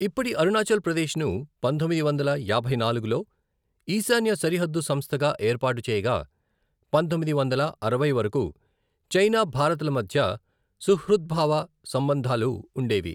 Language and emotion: Telugu, neutral